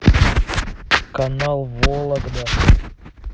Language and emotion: Russian, neutral